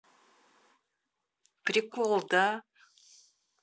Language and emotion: Russian, positive